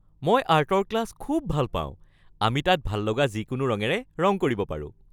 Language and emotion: Assamese, happy